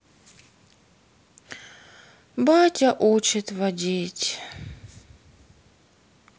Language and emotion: Russian, sad